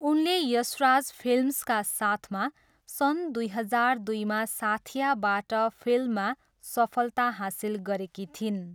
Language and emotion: Nepali, neutral